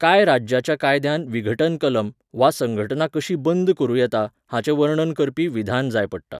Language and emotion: Goan Konkani, neutral